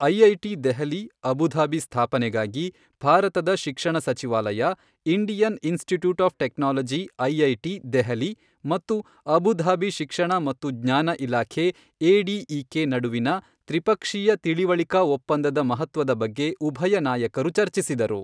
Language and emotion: Kannada, neutral